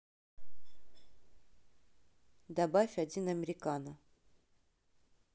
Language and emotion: Russian, neutral